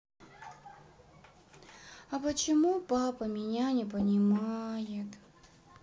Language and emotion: Russian, sad